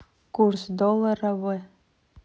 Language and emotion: Russian, neutral